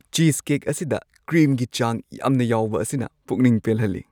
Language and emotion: Manipuri, happy